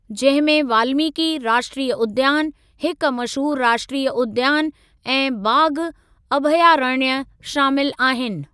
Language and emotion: Sindhi, neutral